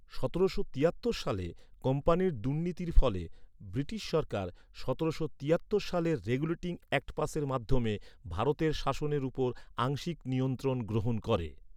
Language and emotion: Bengali, neutral